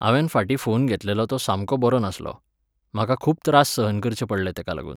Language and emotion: Goan Konkani, neutral